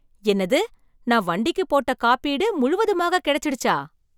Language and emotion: Tamil, surprised